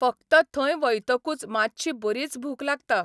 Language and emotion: Goan Konkani, neutral